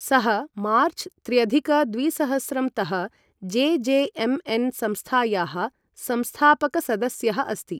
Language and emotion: Sanskrit, neutral